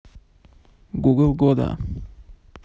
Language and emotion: Russian, neutral